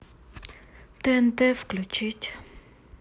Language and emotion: Russian, sad